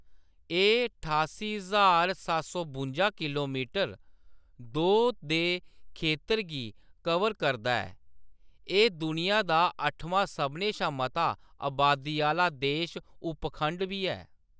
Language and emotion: Dogri, neutral